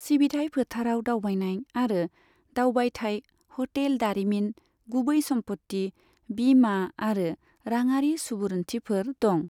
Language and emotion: Bodo, neutral